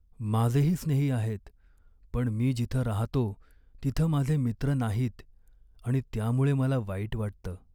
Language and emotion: Marathi, sad